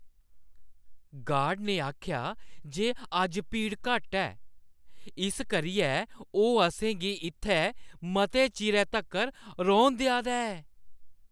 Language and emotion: Dogri, happy